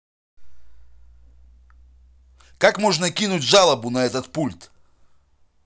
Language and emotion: Russian, angry